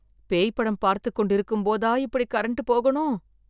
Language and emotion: Tamil, fearful